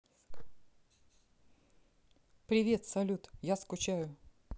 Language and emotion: Russian, neutral